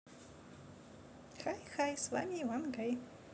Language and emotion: Russian, positive